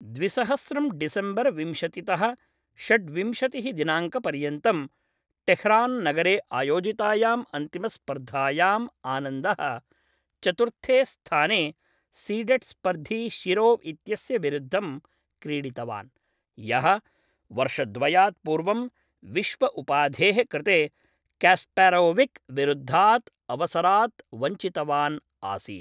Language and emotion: Sanskrit, neutral